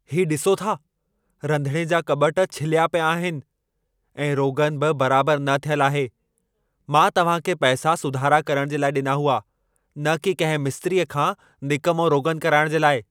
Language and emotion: Sindhi, angry